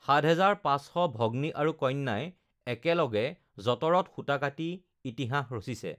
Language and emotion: Assamese, neutral